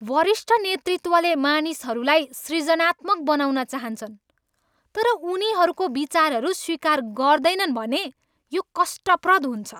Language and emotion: Nepali, angry